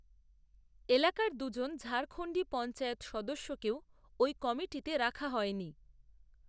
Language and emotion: Bengali, neutral